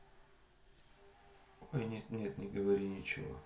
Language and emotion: Russian, neutral